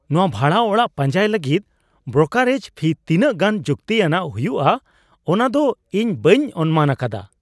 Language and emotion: Santali, surprised